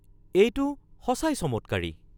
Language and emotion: Assamese, surprised